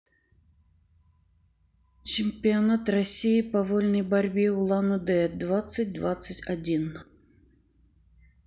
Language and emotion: Russian, neutral